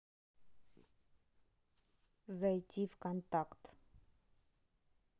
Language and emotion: Russian, neutral